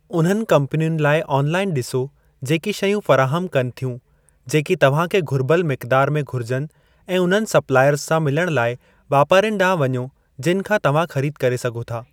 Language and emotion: Sindhi, neutral